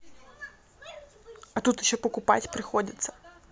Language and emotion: Russian, neutral